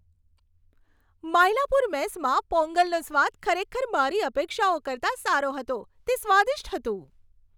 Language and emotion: Gujarati, happy